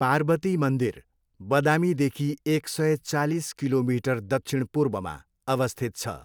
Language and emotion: Nepali, neutral